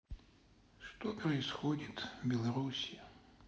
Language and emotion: Russian, sad